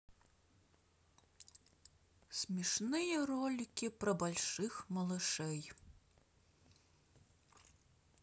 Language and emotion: Russian, sad